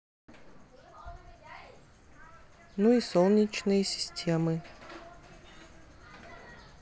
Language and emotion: Russian, neutral